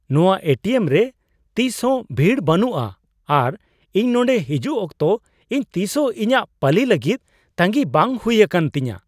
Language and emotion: Santali, surprised